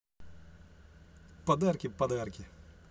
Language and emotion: Russian, positive